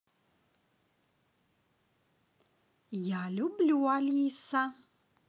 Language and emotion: Russian, positive